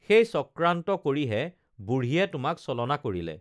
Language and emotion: Assamese, neutral